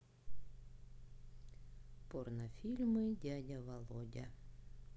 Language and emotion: Russian, neutral